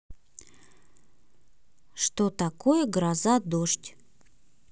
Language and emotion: Russian, neutral